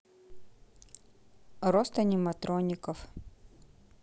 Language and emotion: Russian, neutral